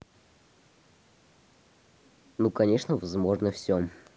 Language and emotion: Russian, neutral